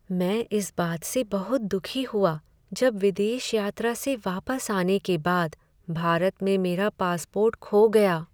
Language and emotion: Hindi, sad